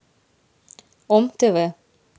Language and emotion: Russian, neutral